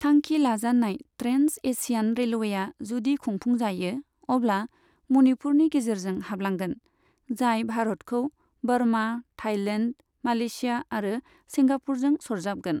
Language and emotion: Bodo, neutral